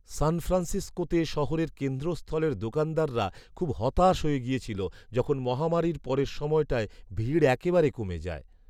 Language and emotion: Bengali, sad